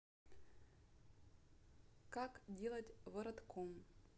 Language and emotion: Russian, neutral